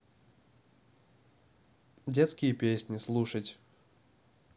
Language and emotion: Russian, neutral